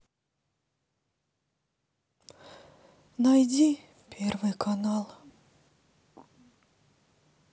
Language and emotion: Russian, sad